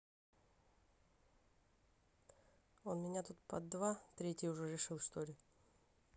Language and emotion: Russian, neutral